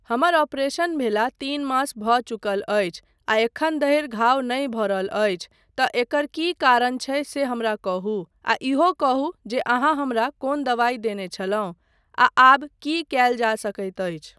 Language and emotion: Maithili, neutral